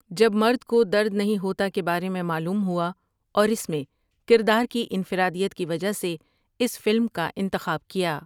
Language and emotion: Urdu, neutral